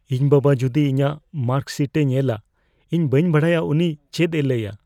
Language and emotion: Santali, fearful